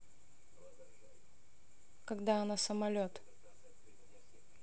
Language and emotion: Russian, neutral